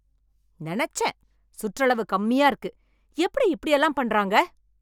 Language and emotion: Tamil, angry